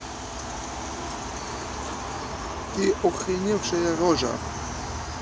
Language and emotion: Russian, neutral